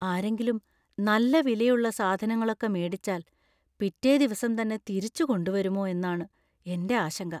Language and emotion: Malayalam, fearful